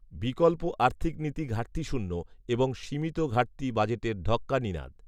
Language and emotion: Bengali, neutral